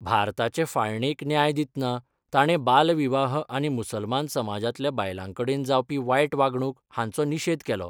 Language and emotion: Goan Konkani, neutral